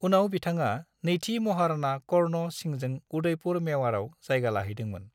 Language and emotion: Bodo, neutral